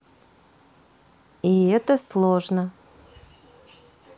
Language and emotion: Russian, neutral